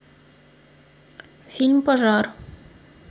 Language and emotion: Russian, neutral